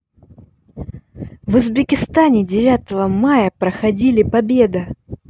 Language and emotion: Russian, positive